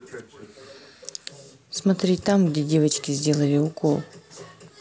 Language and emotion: Russian, neutral